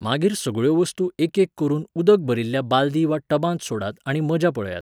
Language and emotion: Goan Konkani, neutral